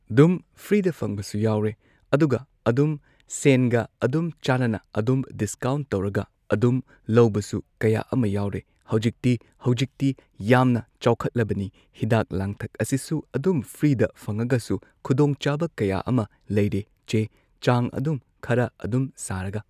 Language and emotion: Manipuri, neutral